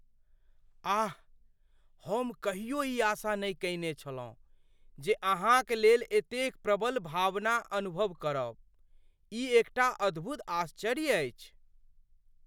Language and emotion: Maithili, surprised